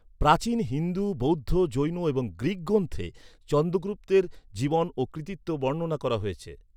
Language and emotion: Bengali, neutral